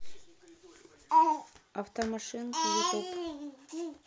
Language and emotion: Russian, neutral